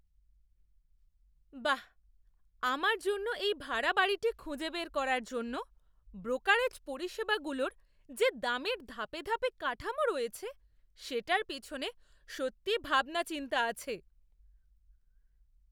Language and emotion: Bengali, surprised